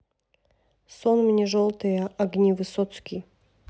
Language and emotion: Russian, neutral